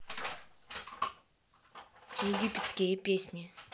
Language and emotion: Russian, neutral